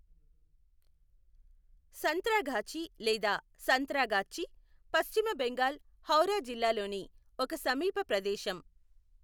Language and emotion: Telugu, neutral